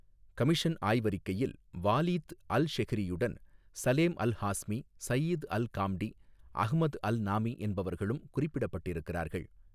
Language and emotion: Tamil, neutral